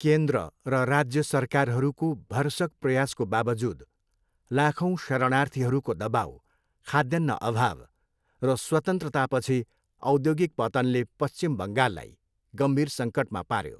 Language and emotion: Nepali, neutral